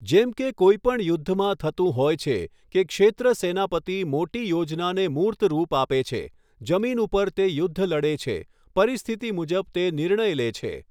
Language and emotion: Gujarati, neutral